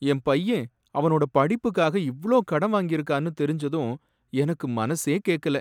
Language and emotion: Tamil, sad